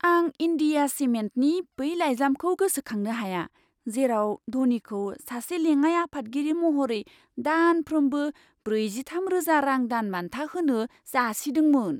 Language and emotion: Bodo, surprised